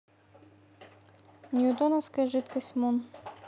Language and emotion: Russian, neutral